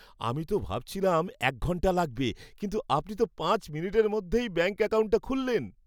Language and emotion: Bengali, happy